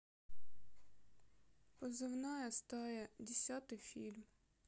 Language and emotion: Russian, sad